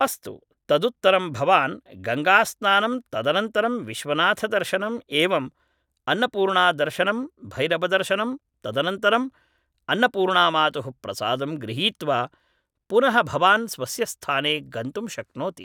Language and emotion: Sanskrit, neutral